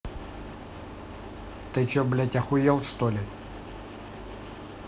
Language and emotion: Russian, angry